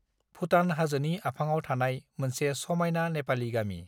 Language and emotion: Bodo, neutral